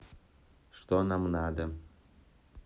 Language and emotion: Russian, neutral